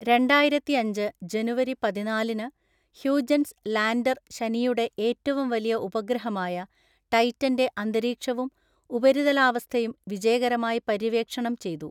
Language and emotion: Malayalam, neutral